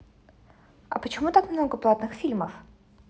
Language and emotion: Russian, neutral